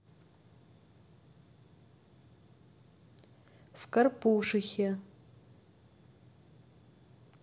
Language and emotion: Russian, neutral